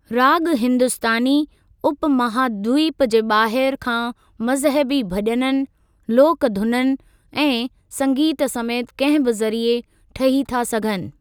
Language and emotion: Sindhi, neutral